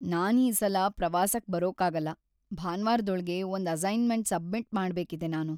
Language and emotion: Kannada, sad